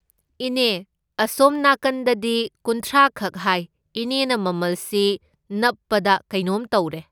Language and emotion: Manipuri, neutral